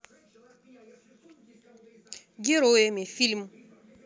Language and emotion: Russian, neutral